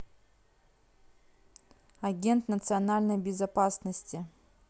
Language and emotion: Russian, neutral